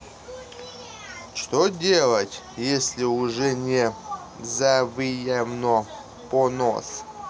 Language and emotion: Russian, neutral